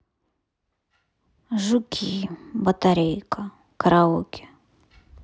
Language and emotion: Russian, sad